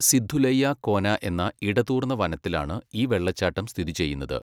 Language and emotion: Malayalam, neutral